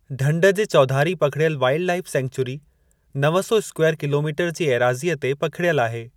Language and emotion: Sindhi, neutral